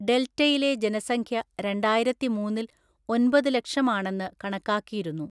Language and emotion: Malayalam, neutral